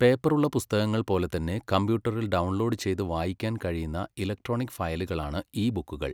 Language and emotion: Malayalam, neutral